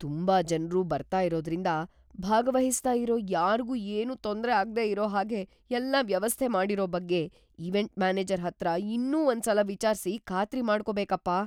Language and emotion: Kannada, fearful